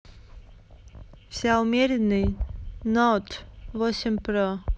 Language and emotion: Russian, neutral